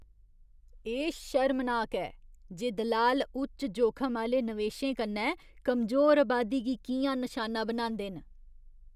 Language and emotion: Dogri, disgusted